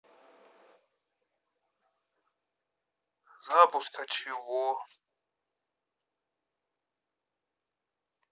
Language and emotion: Russian, sad